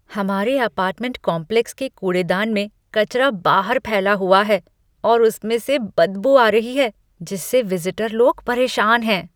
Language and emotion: Hindi, disgusted